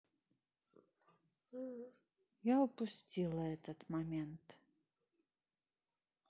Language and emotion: Russian, sad